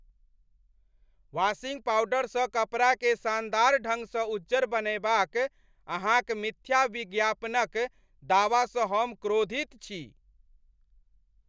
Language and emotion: Maithili, angry